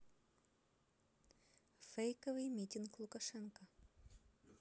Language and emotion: Russian, neutral